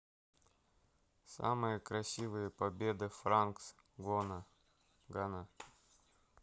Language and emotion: Russian, neutral